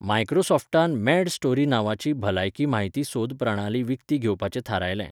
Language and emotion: Goan Konkani, neutral